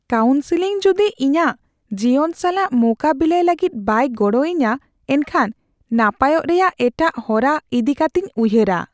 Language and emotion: Santali, fearful